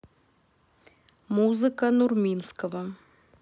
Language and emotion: Russian, neutral